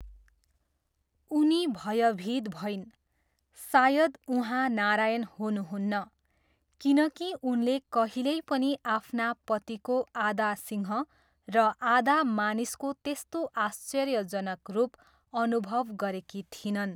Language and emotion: Nepali, neutral